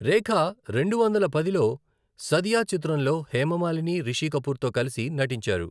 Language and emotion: Telugu, neutral